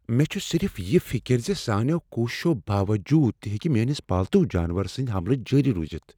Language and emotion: Kashmiri, fearful